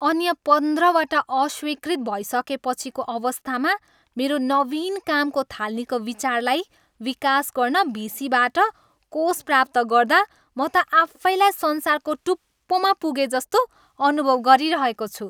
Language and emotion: Nepali, happy